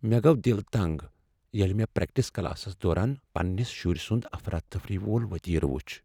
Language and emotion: Kashmiri, sad